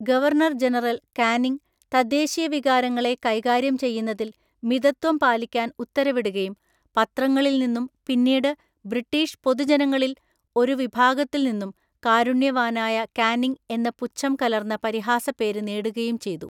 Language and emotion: Malayalam, neutral